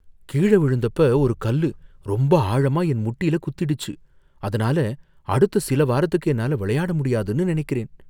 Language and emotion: Tamil, fearful